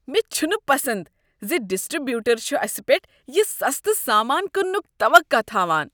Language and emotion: Kashmiri, disgusted